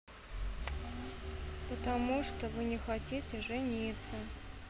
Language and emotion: Russian, sad